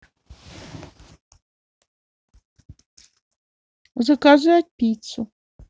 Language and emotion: Russian, neutral